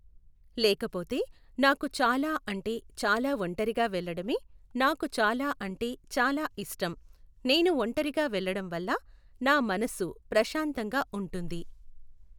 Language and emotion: Telugu, neutral